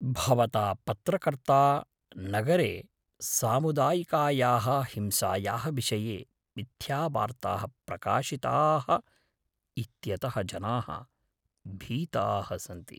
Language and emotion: Sanskrit, fearful